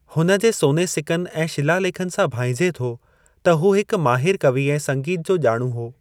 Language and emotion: Sindhi, neutral